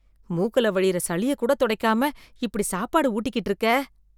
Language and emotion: Tamil, disgusted